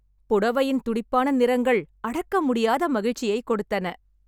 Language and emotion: Tamil, happy